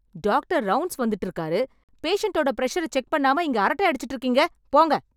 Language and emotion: Tamil, angry